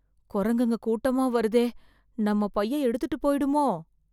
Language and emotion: Tamil, fearful